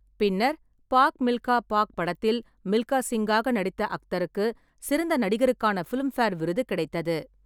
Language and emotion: Tamil, neutral